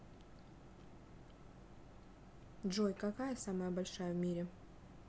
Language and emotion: Russian, neutral